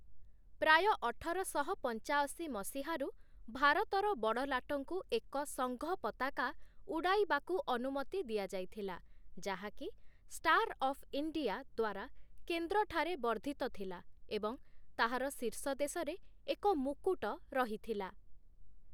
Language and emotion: Odia, neutral